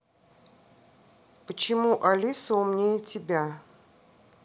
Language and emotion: Russian, neutral